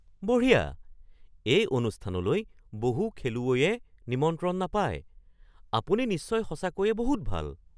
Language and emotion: Assamese, surprised